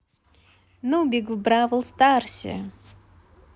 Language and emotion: Russian, positive